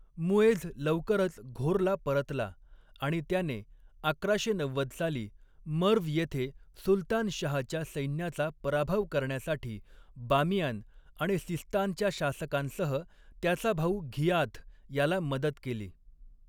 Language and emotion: Marathi, neutral